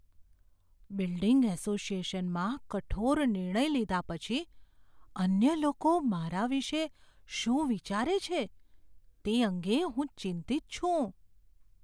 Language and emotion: Gujarati, fearful